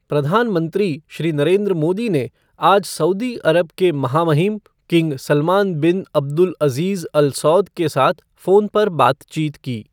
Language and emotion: Hindi, neutral